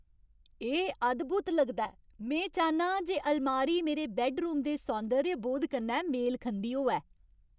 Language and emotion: Dogri, happy